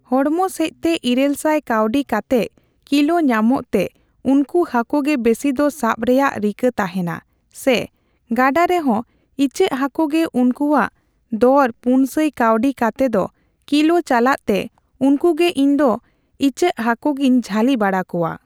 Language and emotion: Santali, neutral